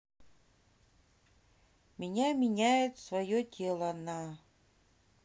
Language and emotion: Russian, neutral